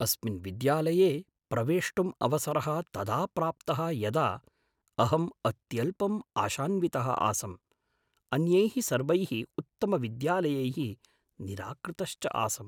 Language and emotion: Sanskrit, surprised